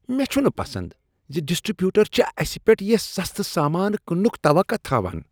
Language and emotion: Kashmiri, disgusted